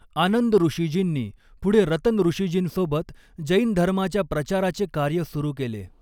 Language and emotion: Marathi, neutral